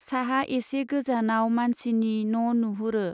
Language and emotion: Bodo, neutral